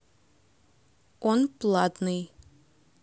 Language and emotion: Russian, neutral